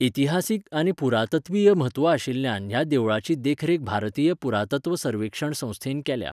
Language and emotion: Goan Konkani, neutral